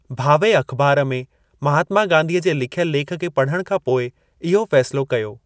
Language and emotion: Sindhi, neutral